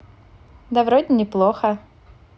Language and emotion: Russian, positive